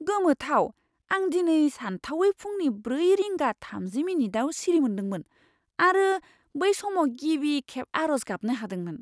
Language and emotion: Bodo, surprised